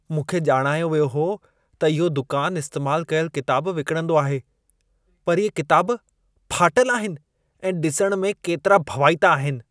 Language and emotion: Sindhi, disgusted